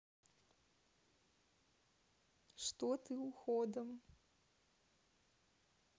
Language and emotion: Russian, neutral